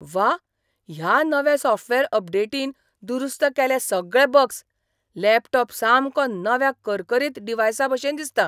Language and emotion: Goan Konkani, surprised